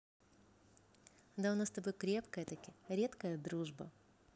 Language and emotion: Russian, positive